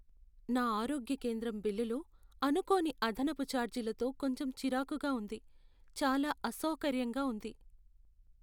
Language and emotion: Telugu, sad